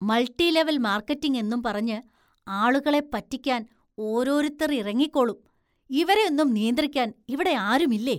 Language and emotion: Malayalam, disgusted